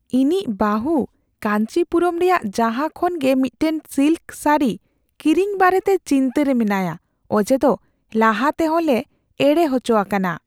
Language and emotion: Santali, fearful